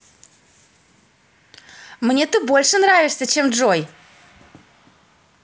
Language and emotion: Russian, positive